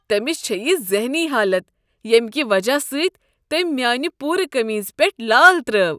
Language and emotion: Kashmiri, disgusted